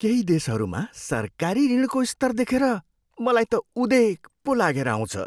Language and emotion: Nepali, surprised